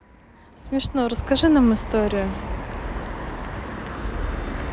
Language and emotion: Russian, positive